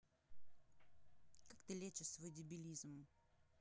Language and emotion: Russian, angry